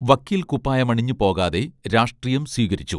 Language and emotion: Malayalam, neutral